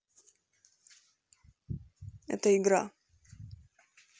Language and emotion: Russian, neutral